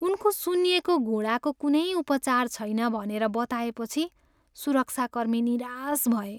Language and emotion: Nepali, sad